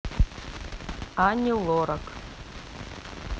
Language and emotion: Russian, neutral